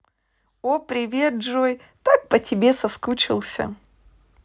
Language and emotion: Russian, positive